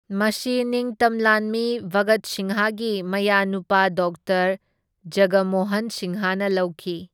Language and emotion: Manipuri, neutral